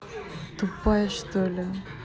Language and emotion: Russian, angry